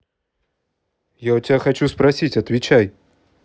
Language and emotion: Russian, angry